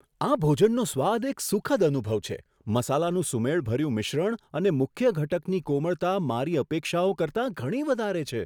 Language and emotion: Gujarati, surprised